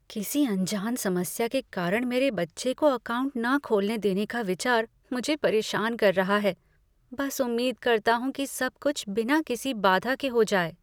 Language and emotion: Hindi, fearful